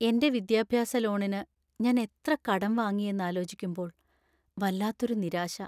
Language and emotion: Malayalam, sad